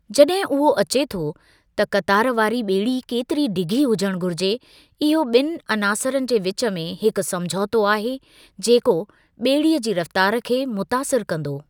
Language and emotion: Sindhi, neutral